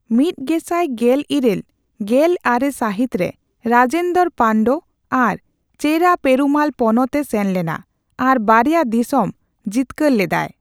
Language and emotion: Santali, neutral